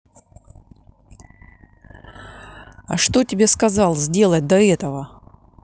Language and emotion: Russian, angry